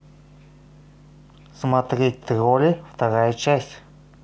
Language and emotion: Russian, neutral